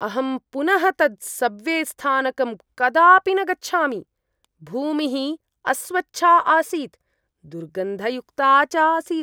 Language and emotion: Sanskrit, disgusted